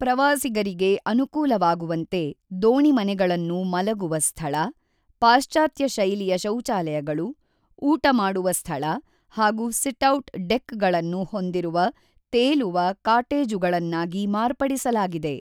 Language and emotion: Kannada, neutral